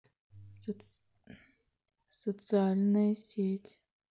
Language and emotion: Russian, sad